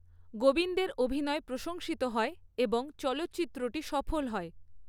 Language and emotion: Bengali, neutral